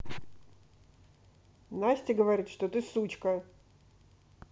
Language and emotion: Russian, angry